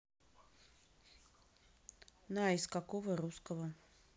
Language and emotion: Russian, neutral